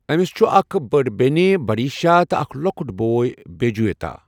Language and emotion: Kashmiri, neutral